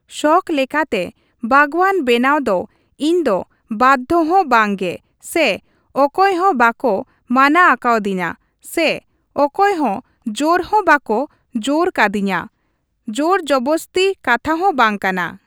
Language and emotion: Santali, neutral